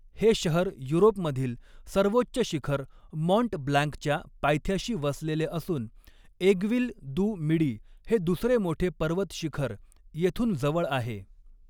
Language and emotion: Marathi, neutral